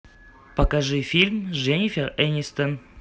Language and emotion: Russian, neutral